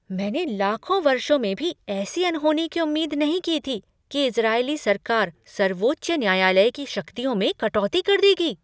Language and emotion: Hindi, surprised